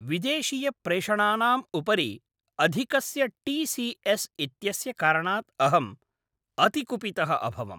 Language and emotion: Sanskrit, angry